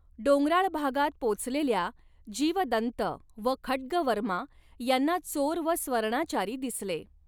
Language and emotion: Marathi, neutral